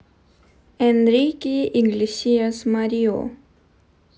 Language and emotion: Russian, neutral